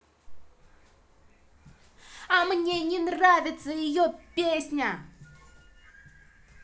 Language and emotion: Russian, angry